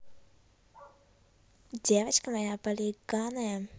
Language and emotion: Russian, neutral